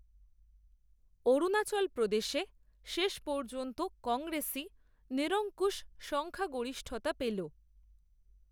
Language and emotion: Bengali, neutral